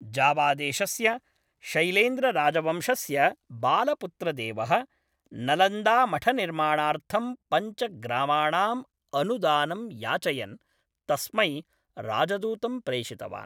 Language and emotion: Sanskrit, neutral